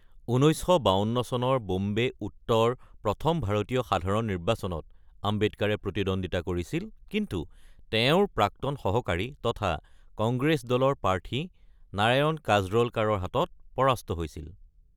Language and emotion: Assamese, neutral